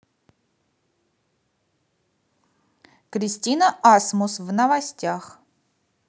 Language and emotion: Russian, neutral